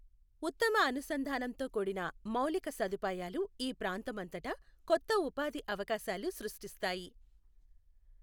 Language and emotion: Telugu, neutral